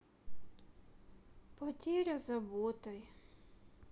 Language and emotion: Russian, sad